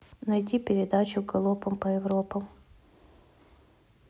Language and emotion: Russian, neutral